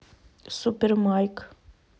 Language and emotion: Russian, neutral